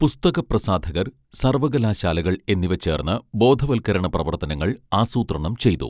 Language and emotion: Malayalam, neutral